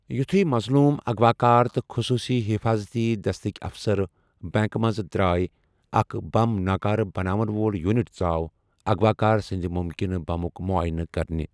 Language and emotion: Kashmiri, neutral